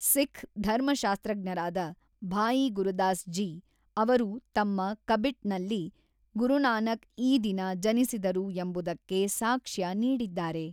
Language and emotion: Kannada, neutral